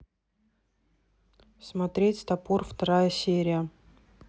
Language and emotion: Russian, neutral